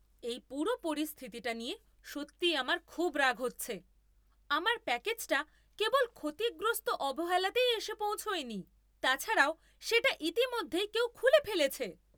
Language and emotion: Bengali, angry